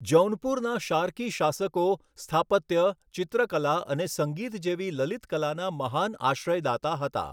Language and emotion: Gujarati, neutral